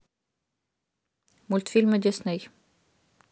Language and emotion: Russian, neutral